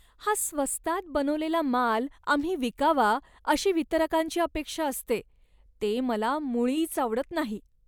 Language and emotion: Marathi, disgusted